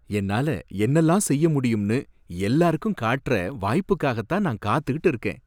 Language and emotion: Tamil, happy